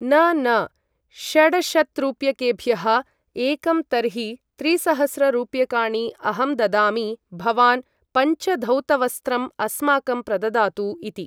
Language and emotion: Sanskrit, neutral